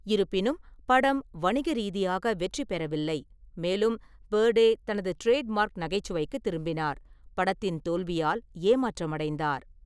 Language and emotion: Tamil, neutral